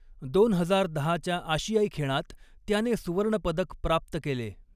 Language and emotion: Marathi, neutral